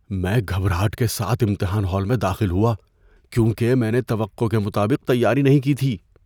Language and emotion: Urdu, fearful